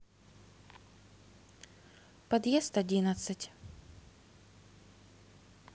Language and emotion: Russian, neutral